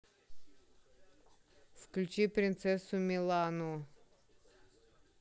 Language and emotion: Russian, neutral